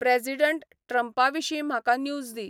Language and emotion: Goan Konkani, neutral